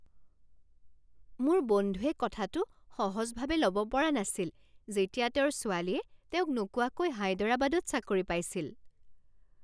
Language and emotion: Assamese, surprised